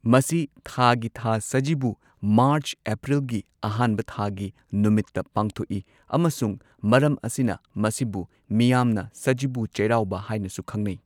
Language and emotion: Manipuri, neutral